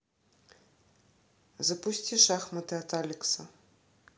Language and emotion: Russian, neutral